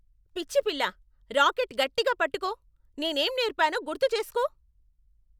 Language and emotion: Telugu, angry